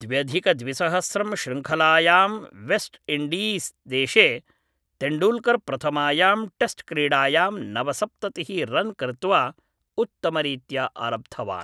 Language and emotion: Sanskrit, neutral